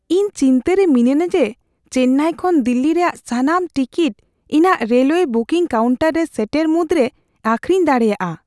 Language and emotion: Santali, fearful